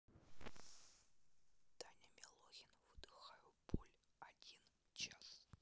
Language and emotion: Russian, neutral